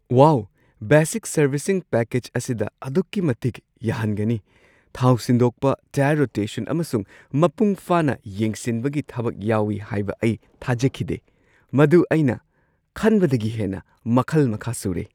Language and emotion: Manipuri, surprised